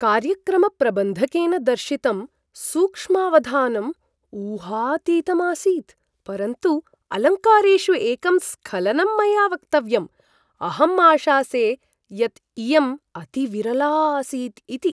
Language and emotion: Sanskrit, surprised